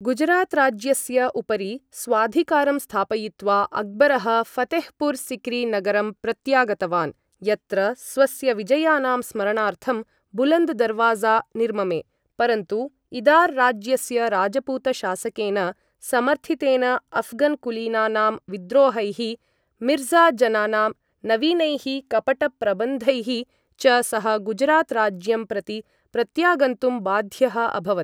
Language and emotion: Sanskrit, neutral